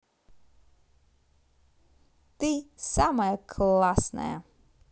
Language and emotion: Russian, positive